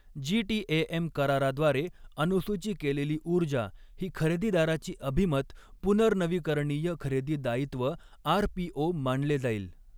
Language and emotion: Marathi, neutral